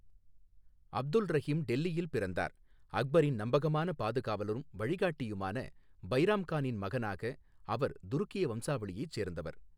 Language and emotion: Tamil, neutral